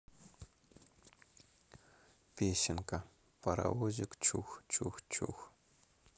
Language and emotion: Russian, neutral